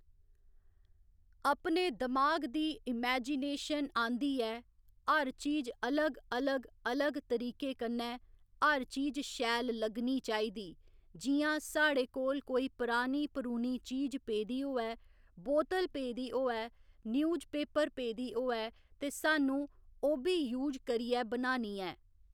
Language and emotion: Dogri, neutral